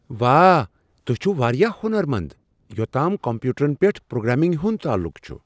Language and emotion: Kashmiri, surprised